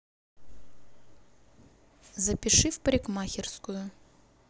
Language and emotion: Russian, neutral